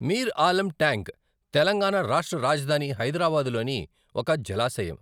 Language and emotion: Telugu, neutral